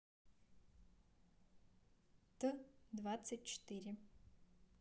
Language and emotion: Russian, neutral